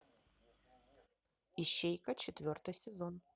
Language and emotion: Russian, neutral